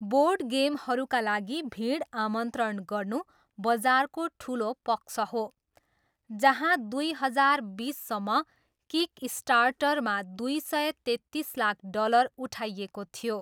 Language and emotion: Nepali, neutral